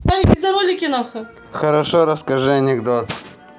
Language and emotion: Russian, positive